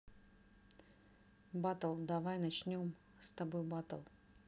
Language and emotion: Russian, neutral